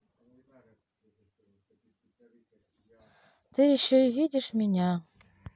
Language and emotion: Russian, neutral